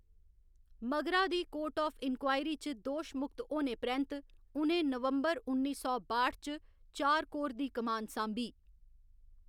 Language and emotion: Dogri, neutral